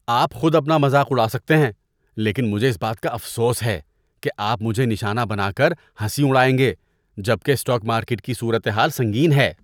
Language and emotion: Urdu, disgusted